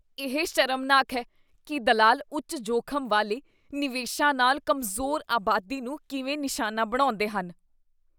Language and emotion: Punjabi, disgusted